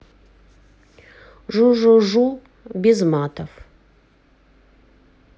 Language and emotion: Russian, neutral